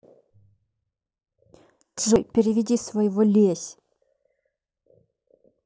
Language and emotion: Russian, angry